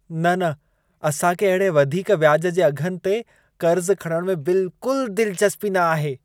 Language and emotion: Sindhi, disgusted